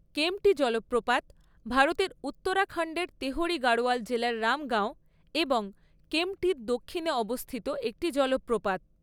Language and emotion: Bengali, neutral